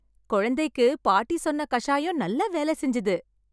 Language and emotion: Tamil, happy